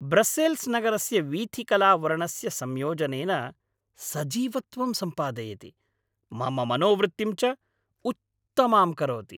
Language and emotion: Sanskrit, happy